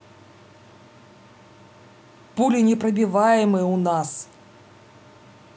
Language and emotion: Russian, angry